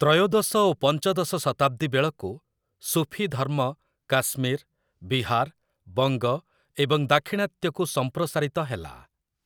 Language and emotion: Odia, neutral